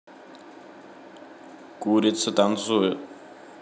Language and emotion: Russian, neutral